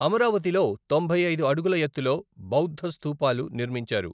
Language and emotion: Telugu, neutral